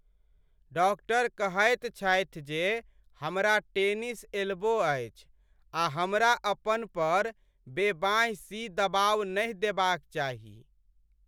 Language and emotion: Maithili, sad